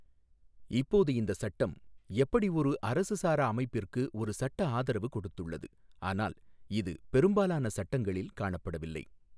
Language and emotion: Tamil, neutral